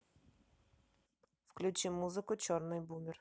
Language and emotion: Russian, neutral